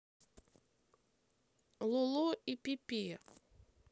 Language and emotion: Russian, neutral